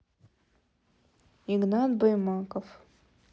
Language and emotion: Russian, neutral